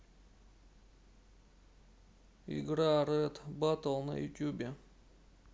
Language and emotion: Russian, neutral